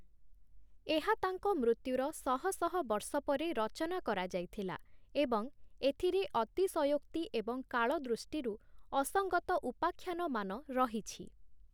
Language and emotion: Odia, neutral